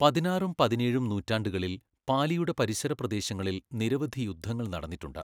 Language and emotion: Malayalam, neutral